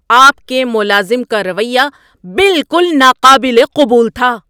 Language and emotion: Urdu, angry